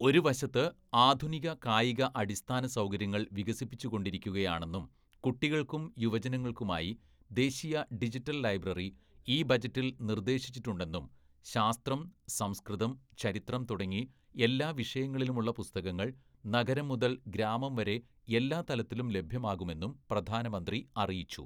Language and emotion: Malayalam, neutral